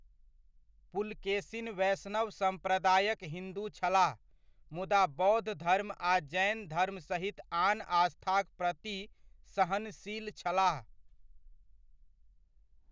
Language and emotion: Maithili, neutral